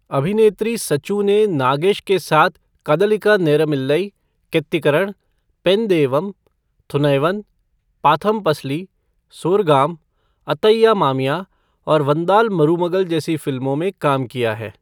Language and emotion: Hindi, neutral